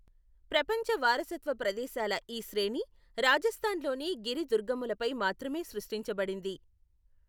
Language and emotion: Telugu, neutral